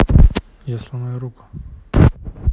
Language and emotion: Russian, neutral